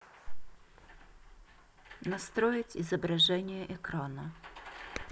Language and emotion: Russian, neutral